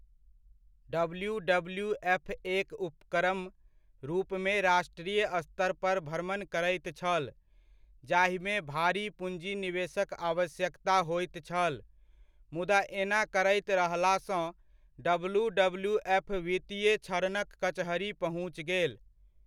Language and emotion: Maithili, neutral